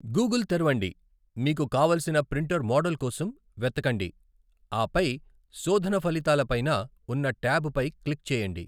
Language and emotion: Telugu, neutral